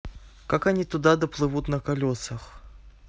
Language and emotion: Russian, neutral